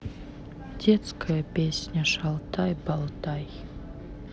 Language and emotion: Russian, sad